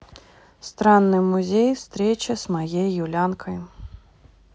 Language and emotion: Russian, neutral